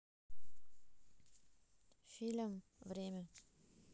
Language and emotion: Russian, neutral